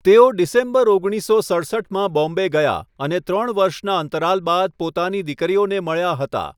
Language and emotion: Gujarati, neutral